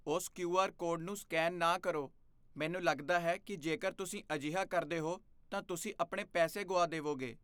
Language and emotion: Punjabi, fearful